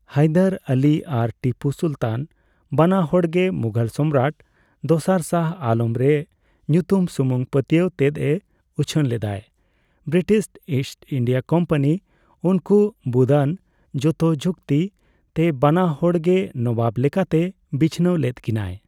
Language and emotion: Santali, neutral